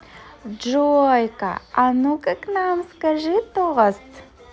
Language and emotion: Russian, positive